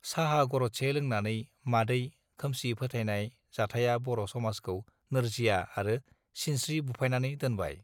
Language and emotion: Bodo, neutral